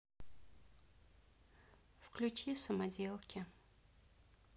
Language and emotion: Russian, neutral